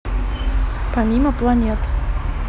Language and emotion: Russian, neutral